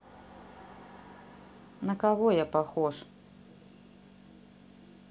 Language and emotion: Russian, neutral